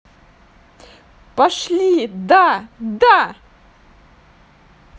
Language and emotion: Russian, positive